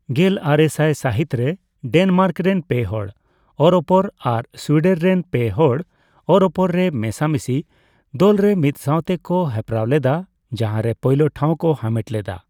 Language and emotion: Santali, neutral